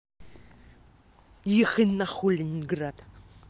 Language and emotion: Russian, angry